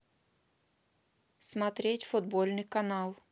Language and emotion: Russian, neutral